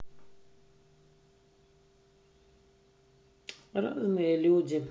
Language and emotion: Russian, sad